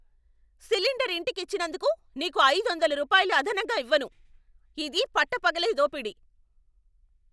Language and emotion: Telugu, angry